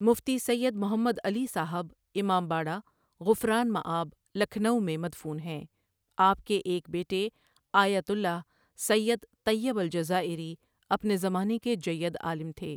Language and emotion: Urdu, neutral